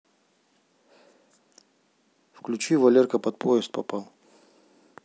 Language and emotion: Russian, neutral